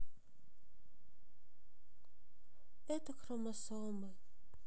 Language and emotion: Russian, sad